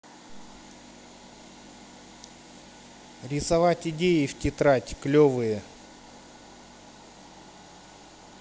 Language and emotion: Russian, neutral